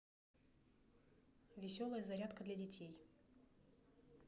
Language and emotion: Russian, neutral